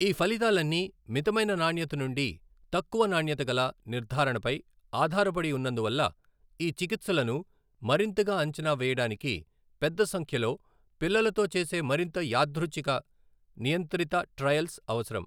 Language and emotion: Telugu, neutral